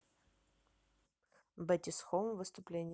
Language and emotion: Russian, neutral